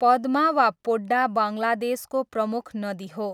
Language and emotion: Nepali, neutral